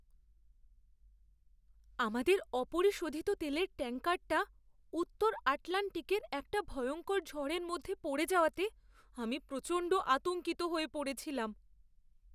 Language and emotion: Bengali, fearful